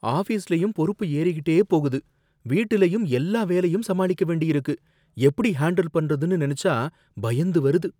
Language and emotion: Tamil, fearful